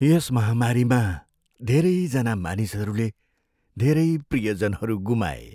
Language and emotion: Nepali, sad